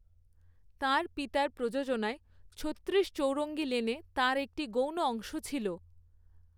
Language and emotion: Bengali, neutral